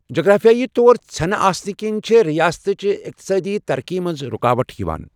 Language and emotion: Kashmiri, neutral